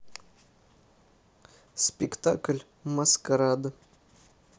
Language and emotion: Russian, neutral